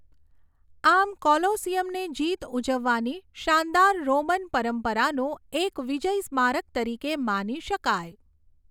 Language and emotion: Gujarati, neutral